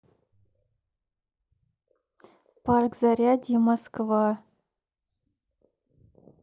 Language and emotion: Russian, neutral